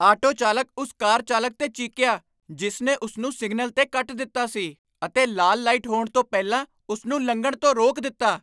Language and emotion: Punjabi, angry